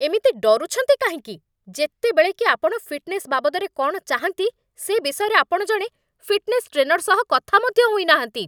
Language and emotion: Odia, angry